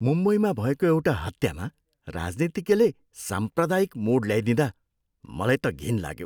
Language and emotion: Nepali, disgusted